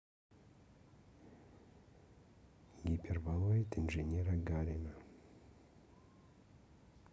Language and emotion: Russian, neutral